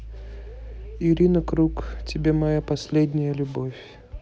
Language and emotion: Russian, neutral